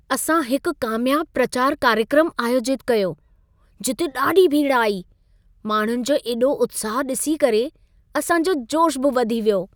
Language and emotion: Sindhi, happy